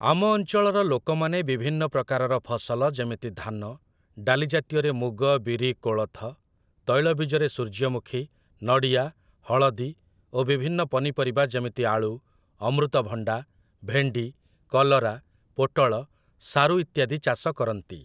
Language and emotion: Odia, neutral